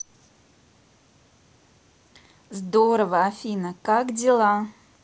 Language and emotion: Russian, positive